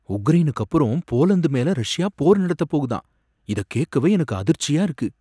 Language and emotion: Tamil, surprised